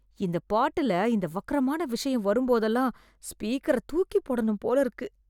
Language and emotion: Tamil, disgusted